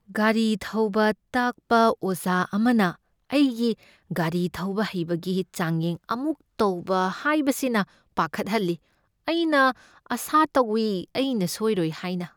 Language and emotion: Manipuri, fearful